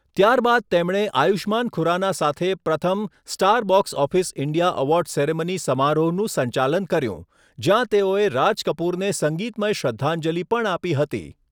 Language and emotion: Gujarati, neutral